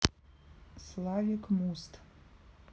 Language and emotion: Russian, neutral